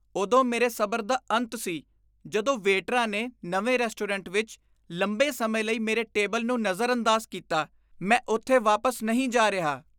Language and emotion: Punjabi, disgusted